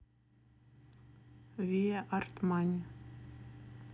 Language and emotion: Russian, neutral